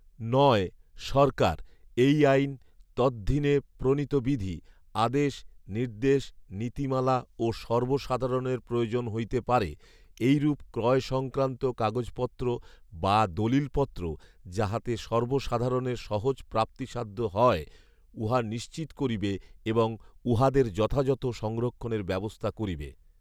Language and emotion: Bengali, neutral